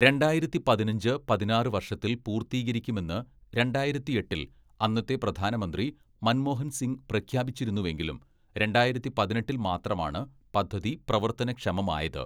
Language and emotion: Malayalam, neutral